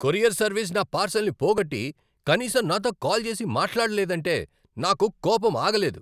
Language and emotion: Telugu, angry